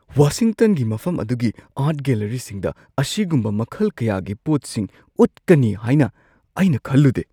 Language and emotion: Manipuri, surprised